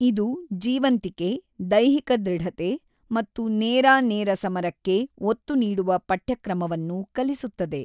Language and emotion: Kannada, neutral